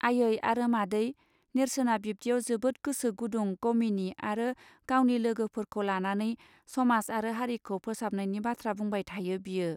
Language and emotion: Bodo, neutral